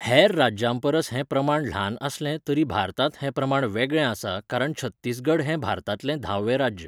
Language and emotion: Goan Konkani, neutral